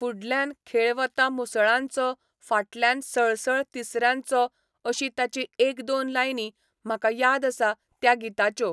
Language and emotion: Goan Konkani, neutral